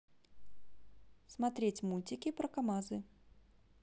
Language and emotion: Russian, neutral